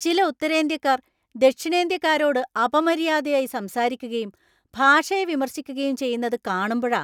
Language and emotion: Malayalam, angry